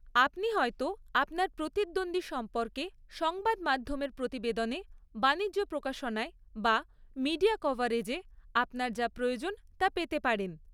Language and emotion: Bengali, neutral